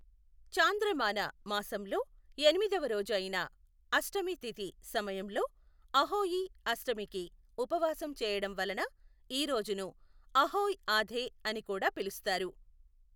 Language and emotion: Telugu, neutral